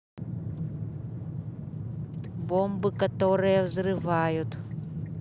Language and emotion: Russian, neutral